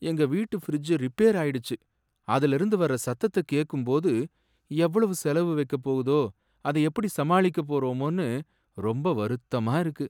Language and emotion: Tamil, sad